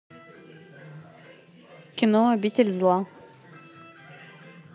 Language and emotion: Russian, neutral